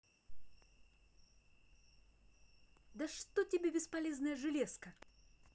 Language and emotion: Russian, angry